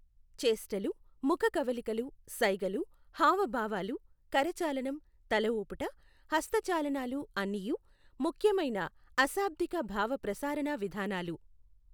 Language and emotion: Telugu, neutral